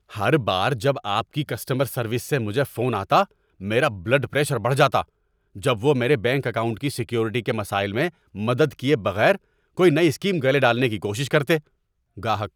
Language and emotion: Urdu, angry